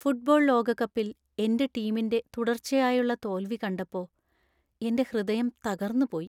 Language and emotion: Malayalam, sad